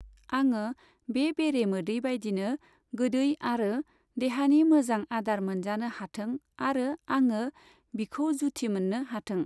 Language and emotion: Bodo, neutral